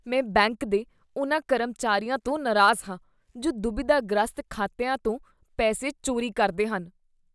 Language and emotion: Punjabi, disgusted